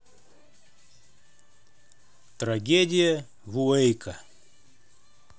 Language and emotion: Russian, neutral